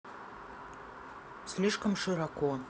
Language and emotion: Russian, neutral